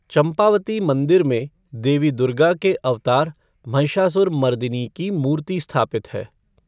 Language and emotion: Hindi, neutral